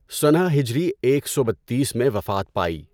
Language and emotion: Urdu, neutral